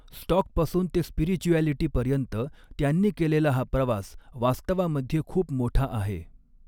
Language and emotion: Marathi, neutral